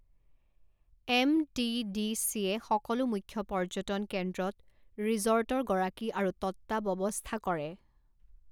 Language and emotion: Assamese, neutral